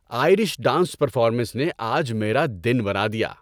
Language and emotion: Urdu, happy